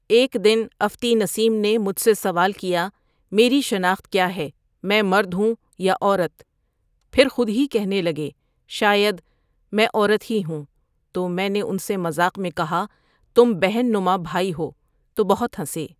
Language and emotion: Urdu, neutral